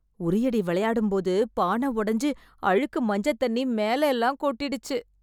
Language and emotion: Tamil, disgusted